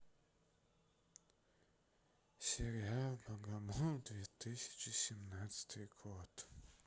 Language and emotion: Russian, sad